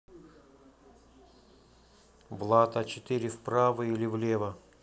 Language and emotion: Russian, neutral